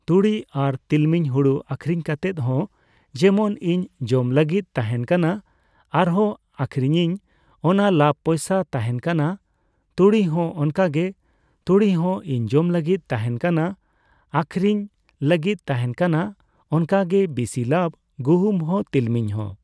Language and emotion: Santali, neutral